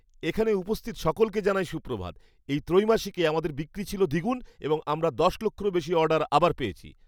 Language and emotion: Bengali, happy